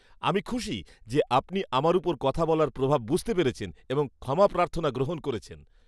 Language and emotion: Bengali, happy